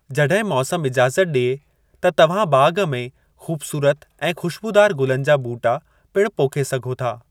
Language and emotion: Sindhi, neutral